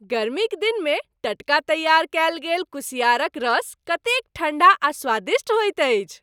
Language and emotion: Maithili, happy